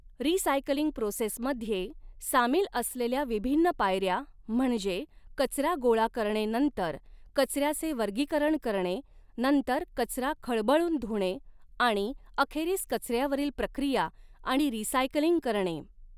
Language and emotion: Marathi, neutral